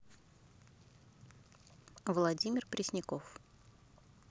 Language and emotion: Russian, neutral